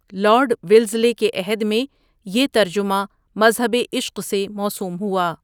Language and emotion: Urdu, neutral